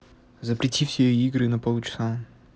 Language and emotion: Russian, neutral